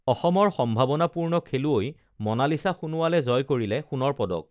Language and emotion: Assamese, neutral